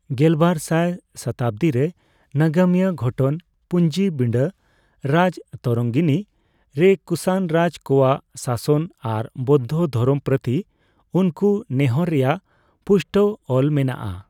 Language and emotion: Santali, neutral